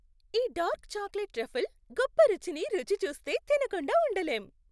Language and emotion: Telugu, happy